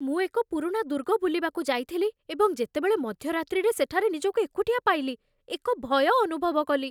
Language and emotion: Odia, fearful